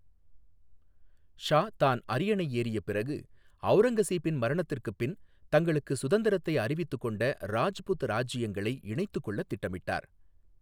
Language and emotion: Tamil, neutral